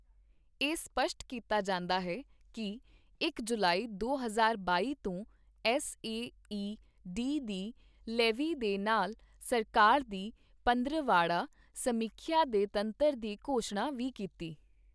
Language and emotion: Punjabi, neutral